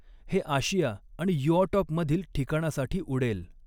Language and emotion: Marathi, neutral